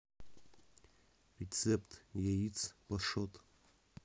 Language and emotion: Russian, neutral